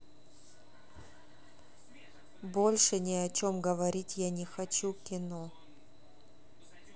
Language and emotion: Russian, neutral